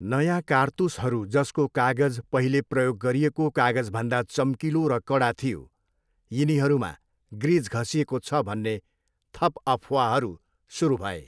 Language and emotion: Nepali, neutral